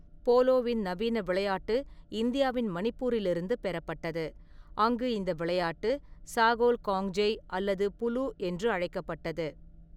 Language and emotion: Tamil, neutral